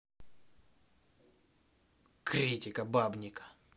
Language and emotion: Russian, angry